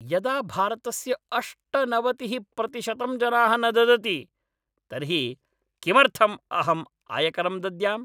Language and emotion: Sanskrit, angry